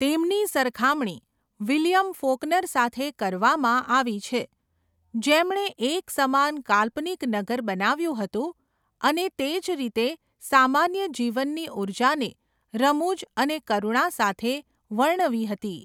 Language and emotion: Gujarati, neutral